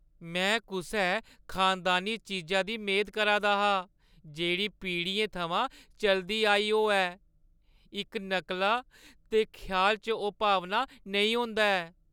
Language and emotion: Dogri, sad